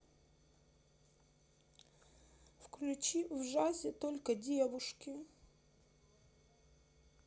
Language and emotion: Russian, sad